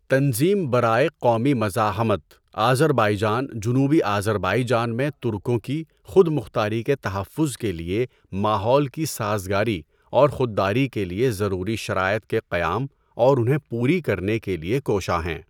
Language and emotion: Urdu, neutral